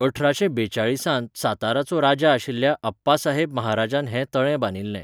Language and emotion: Goan Konkani, neutral